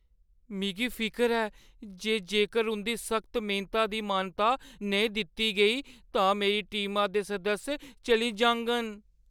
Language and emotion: Dogri, fearful